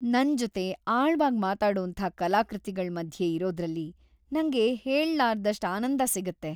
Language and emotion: Kannada, happy